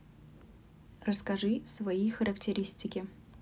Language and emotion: Russian, neutral